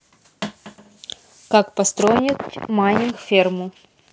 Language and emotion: Russian, neutral